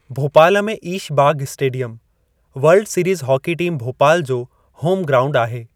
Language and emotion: Sindhi, neutral